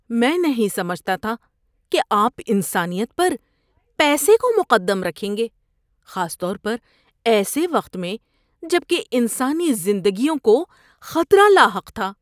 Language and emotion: Urdu, disgusted